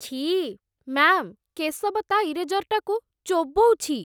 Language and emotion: Odia, disgusted